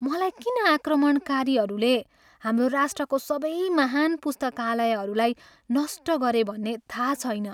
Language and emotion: Nepali, sad